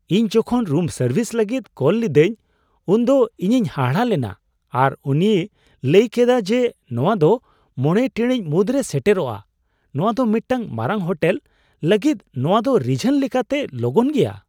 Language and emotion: Santali, surprised